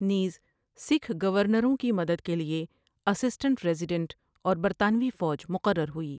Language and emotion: Urdu, neutral